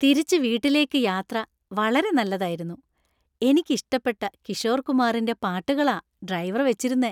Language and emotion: Malayalam, happy